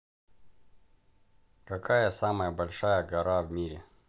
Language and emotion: Russian, neutral